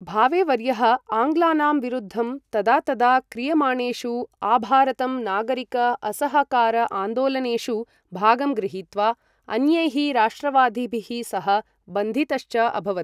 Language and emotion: Sanskrit, neutral